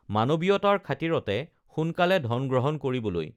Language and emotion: Assamese, neutral